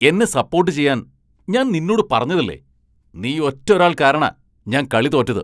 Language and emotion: Malayalam, angry